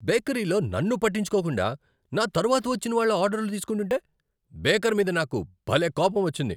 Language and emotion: Telugu, angry